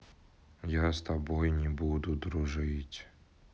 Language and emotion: Russian, sad